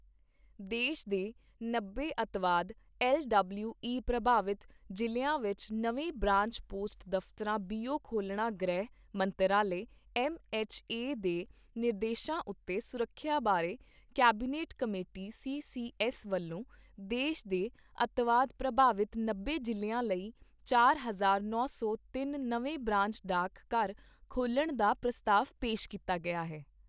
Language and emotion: Punjabi, neutral